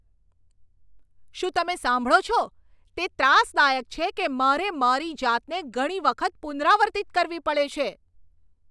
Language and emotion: Gujarati, angry